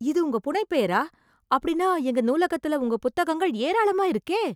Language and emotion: Tamil, surprised